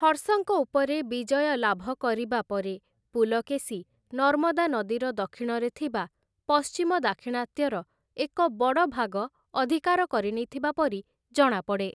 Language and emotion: Odia, neutral